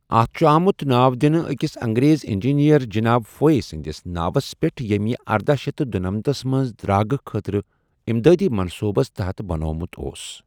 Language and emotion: Kashmiri, neutral